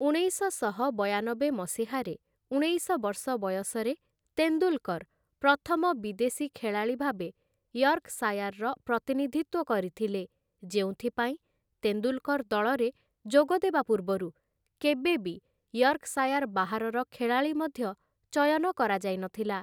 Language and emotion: Odia, neutral